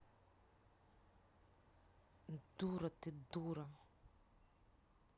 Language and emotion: Russian, angry